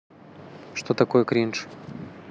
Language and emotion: Russian, neutral